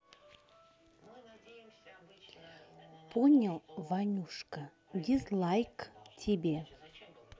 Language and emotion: Russian, neutral